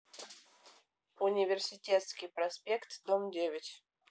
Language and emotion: Russian, neutral